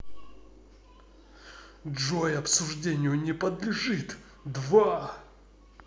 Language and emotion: Russian, angry